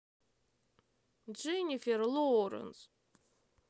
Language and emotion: Russian, sad